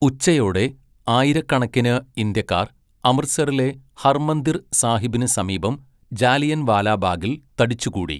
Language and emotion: Malayalam, neutral